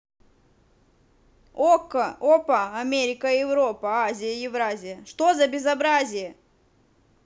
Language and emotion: Russian, angry